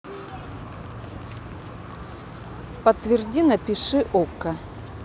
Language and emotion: Russian, neutral